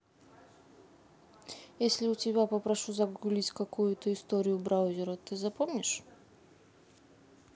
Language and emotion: Russian, neutral